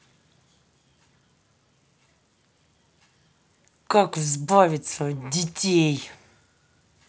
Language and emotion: Russian, angry